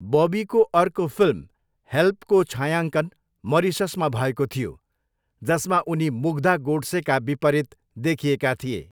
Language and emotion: Nepali, neutral